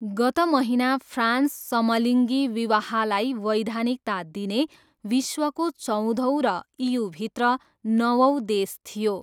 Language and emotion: Nepali, neutral